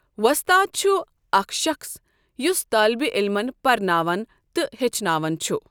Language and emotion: Kashmiri, neutral